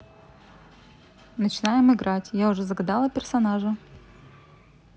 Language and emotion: Russian, neutral